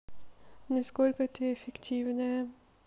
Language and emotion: Russian, neutral